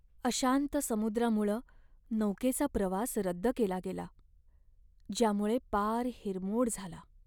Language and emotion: Marathi, sad